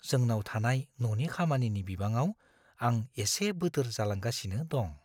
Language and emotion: Bodo, fearful